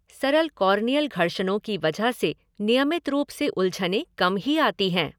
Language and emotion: Hindi, neutral